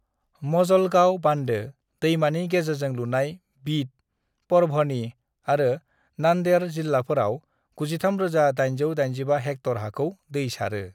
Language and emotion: Bodo, neutral